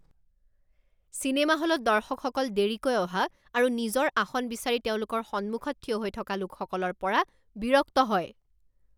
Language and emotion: Assamese, angry